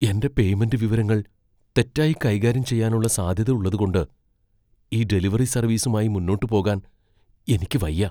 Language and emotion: Malayalam, fearful